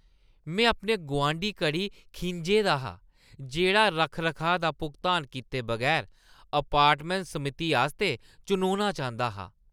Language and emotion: Dogri, disgusted